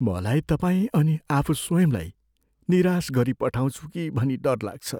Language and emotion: Nepali, fearful